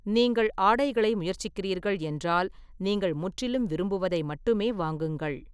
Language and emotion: Tamil, neutral